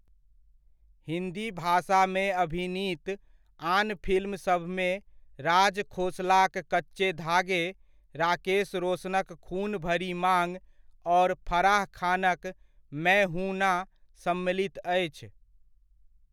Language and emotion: Maithili, neutral